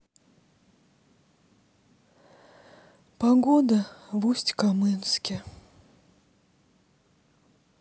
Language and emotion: Russian, sad